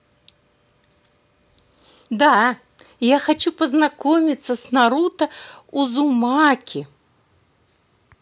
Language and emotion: Russian, positive